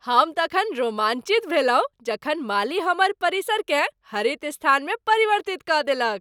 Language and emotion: Maithili, happy